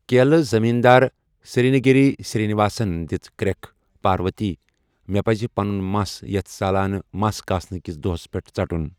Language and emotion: Kashmiri, neutral